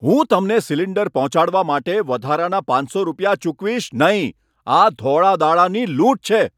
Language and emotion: Gujarati, angry